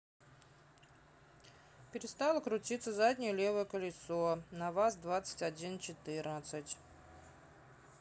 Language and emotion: Russian, neutral